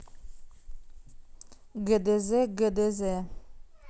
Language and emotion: Russian, neutral